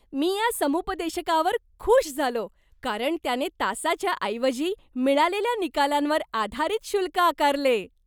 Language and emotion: Marathi, happy